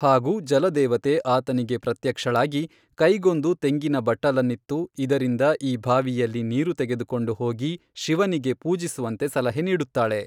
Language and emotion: Kannada, neutral